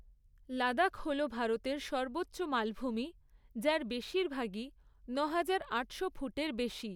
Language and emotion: Bengali, neutral